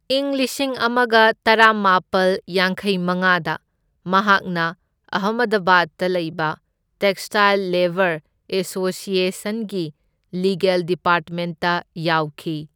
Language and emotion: Manipuri, neutral